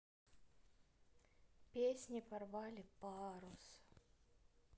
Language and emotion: Russian, neutral